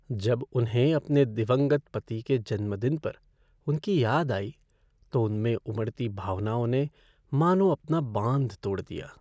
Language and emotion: Hindi, sad